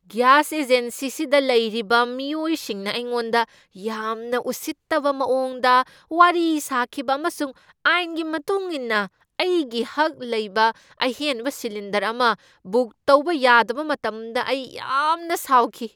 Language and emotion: Manipuri, angry